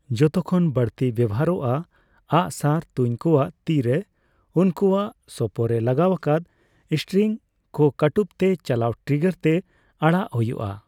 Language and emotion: Santali, neutral